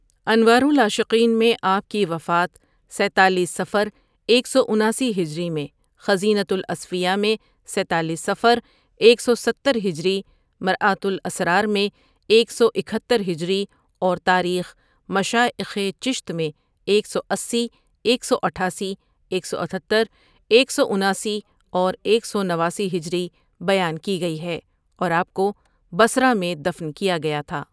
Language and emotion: Urdu, neutral